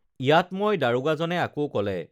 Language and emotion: Assamese, neutral